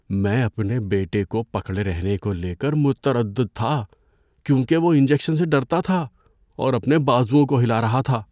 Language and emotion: Urdu, fearful